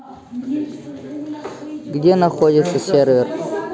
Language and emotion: Russian, neutral